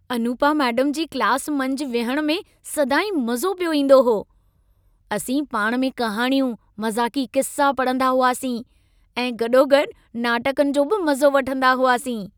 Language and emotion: Sindhi, happy